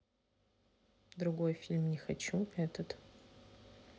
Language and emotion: Russian, neutral